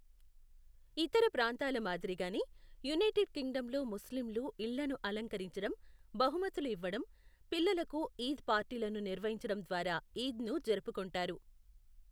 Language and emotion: Telugu, neutral